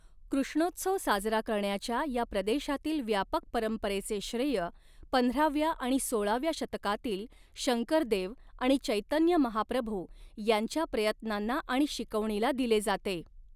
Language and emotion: Marathi, neutral